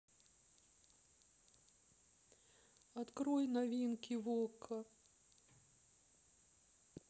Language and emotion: Russian, sad